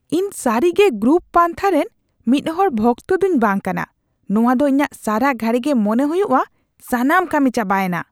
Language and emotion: Santali, disgusted